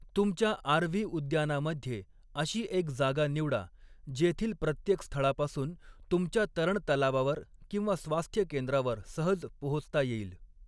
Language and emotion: Marathi, neutral